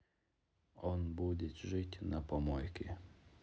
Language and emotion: Russian, neutral